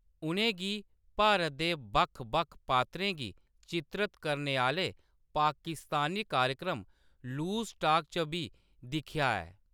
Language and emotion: Dogri, neutral